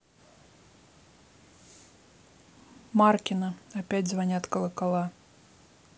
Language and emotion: Russian, neutral